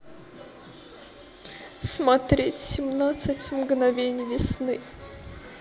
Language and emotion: Russian, sad